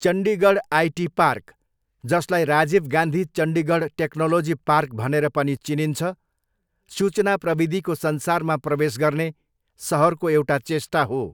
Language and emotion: Nepali, neutral